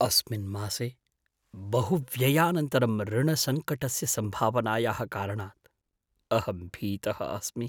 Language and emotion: Sanskrit, fearful